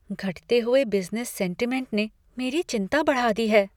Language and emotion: Hindi, fearful